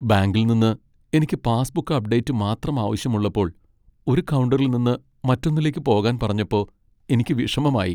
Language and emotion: Malayalam, sad